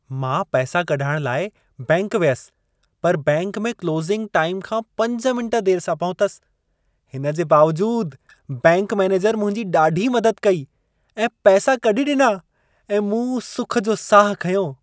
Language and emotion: Sindhi, happy